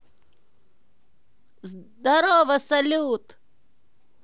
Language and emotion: Russian, positive